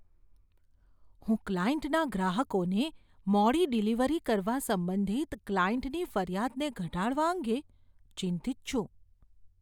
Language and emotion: Gujarati, fearful